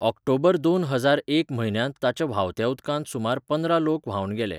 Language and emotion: Goan Konkani, neutral